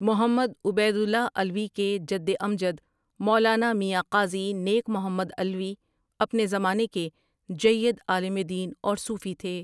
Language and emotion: Urdu, neutral